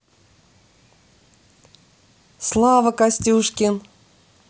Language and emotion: Russian, positive